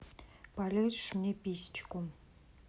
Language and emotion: Russian, neutral